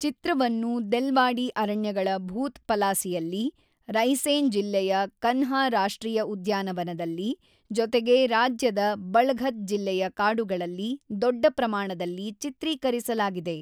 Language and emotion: Kannada, neutral